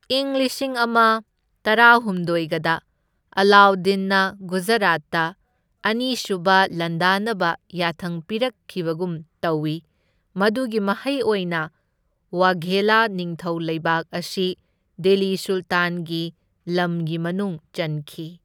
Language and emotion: Manipuri, neutral